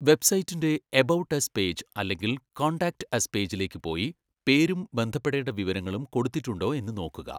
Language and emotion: Malayalam, neutral